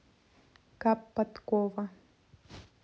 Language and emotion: Russian, neutral